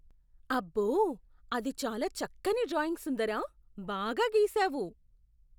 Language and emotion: Telugu, surprised